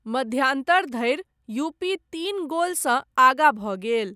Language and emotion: Maithili, neutral